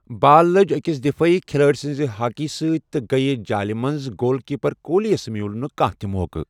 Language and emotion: Kashmiri, neutral